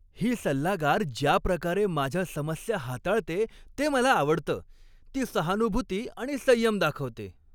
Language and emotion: Marathi, happy